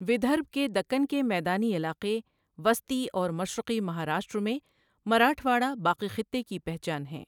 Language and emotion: Urdu, neutral